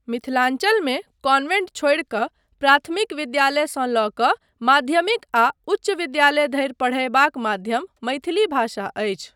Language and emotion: Maithili, neutral